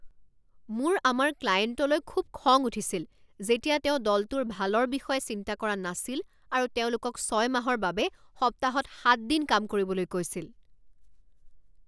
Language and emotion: Assamese, angry